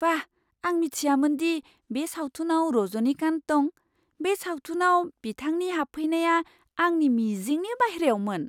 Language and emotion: Bodo, surprised